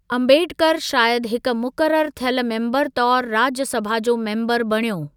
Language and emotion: Sindhi, neutral